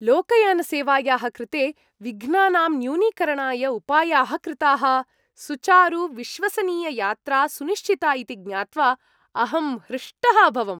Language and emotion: Sanskrit, happy